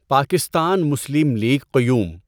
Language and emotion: Urdu, neutral